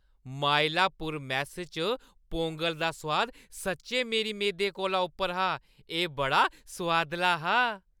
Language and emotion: Dogri, happy